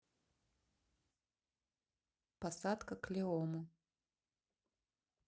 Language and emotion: Russian, neutral